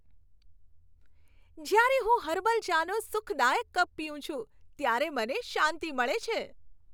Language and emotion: Gujarati, happy